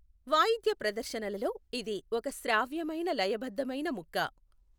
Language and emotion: Telugu, neutral